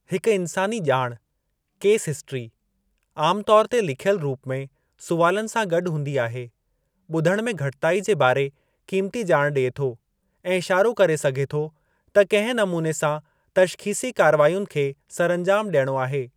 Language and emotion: Sindhi, neutral